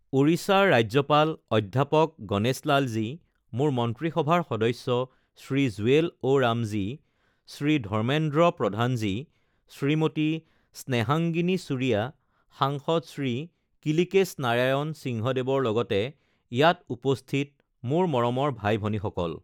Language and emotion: Assamese, neutral